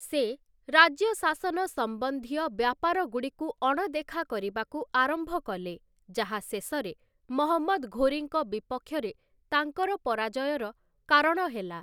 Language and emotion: Odia, neutral